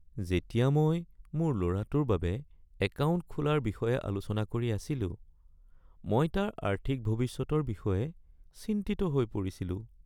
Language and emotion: Assamese, sad